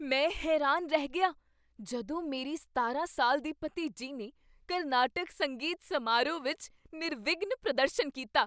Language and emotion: Punjabi, surprised